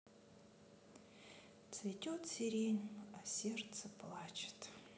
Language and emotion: Russian, sad